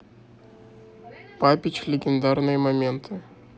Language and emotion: Russian, neutral